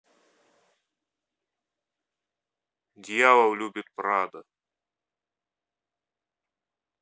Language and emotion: Russian, neutral